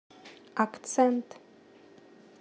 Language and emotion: Russian, neutral